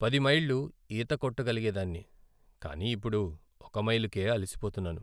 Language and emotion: Telugu, sad